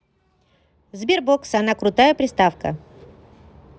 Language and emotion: Russian, positive